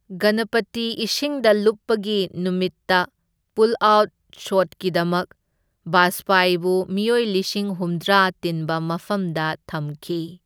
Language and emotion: Manipuri, neutral